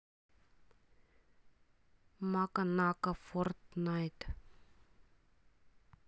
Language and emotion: Russian, neutral